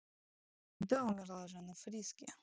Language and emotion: Russian, neutral